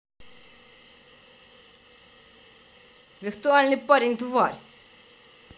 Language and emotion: Russian, angry